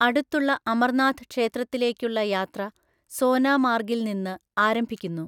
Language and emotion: Malayalam, neutral